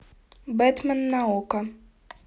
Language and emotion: Russian, neutral